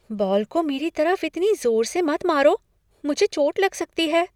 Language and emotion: Hindi, fearful